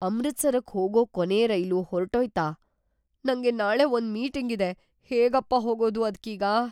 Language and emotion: Kannada, fearful